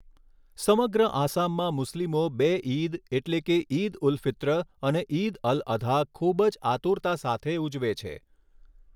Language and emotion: Gujarati, neutral